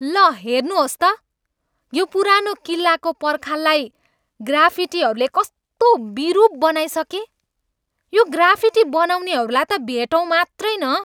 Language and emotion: Nepali, angry